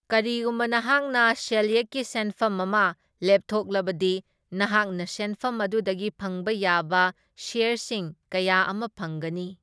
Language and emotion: Manipuri, neutral